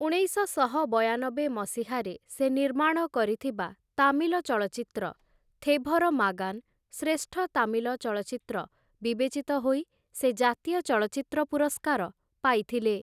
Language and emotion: Odia, neutral